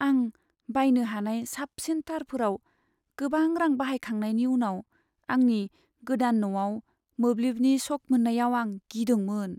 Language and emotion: Bodo, sad